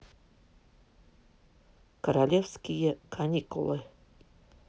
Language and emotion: Russian, neutral